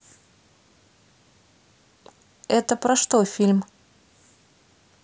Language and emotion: Russian, neutral